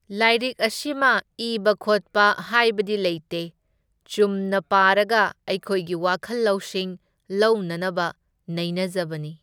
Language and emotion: Manipuri, neutral